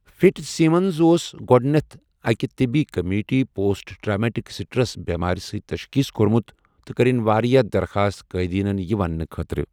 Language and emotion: Kashmiri, neutral